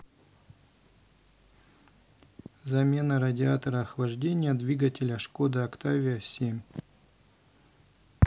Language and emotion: Russian, neutral